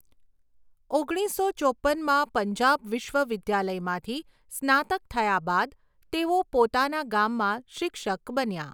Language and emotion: Gujarati, neutral